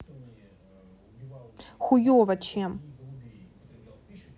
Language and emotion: Russian, angry